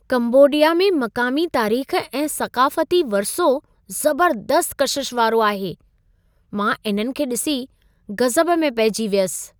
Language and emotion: Sindhi, surprised